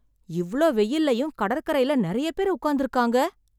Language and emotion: Tamil, surprised